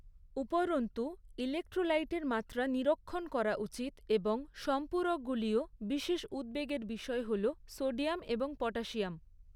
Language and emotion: Bengali, neutral